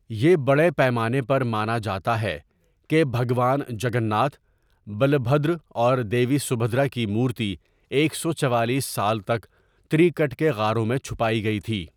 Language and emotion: Urdu, neutral